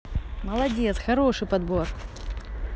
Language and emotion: Russian, positive